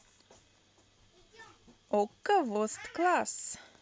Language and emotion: Russian, positive